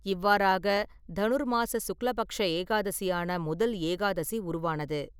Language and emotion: Tamil, neutral